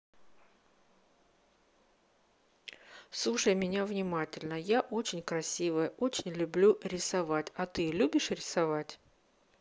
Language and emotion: Russian, neutral